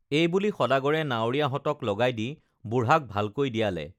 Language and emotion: Assamese, neutral